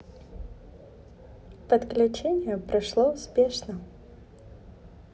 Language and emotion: Russian, positive